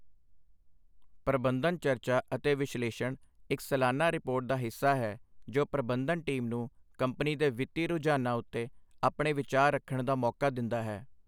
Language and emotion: Punjabi, neutral